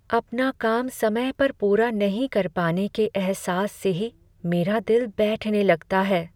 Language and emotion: Hindi, sad